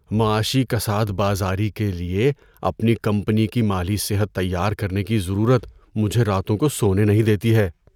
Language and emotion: Urdu, fearful